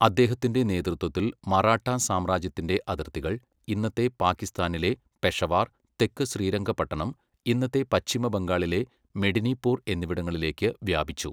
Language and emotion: Malayalam, neutral